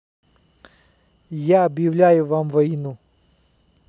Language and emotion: Russian, neutral